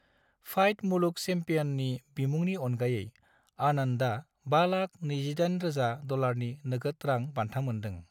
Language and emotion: Bodo, neutral